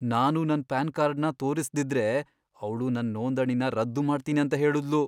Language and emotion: Kannada, fearful